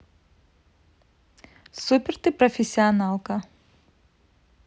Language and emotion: Russian, positive